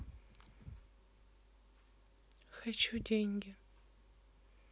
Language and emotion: Russian, sad